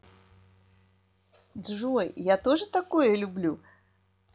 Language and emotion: Russian, positive